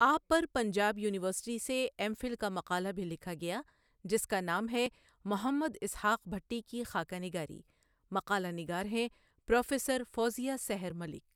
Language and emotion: Urdu, neutral